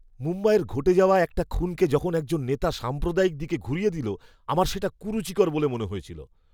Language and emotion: Bengali, disgusted